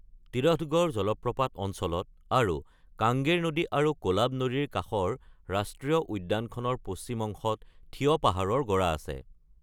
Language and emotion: Assamese, neutral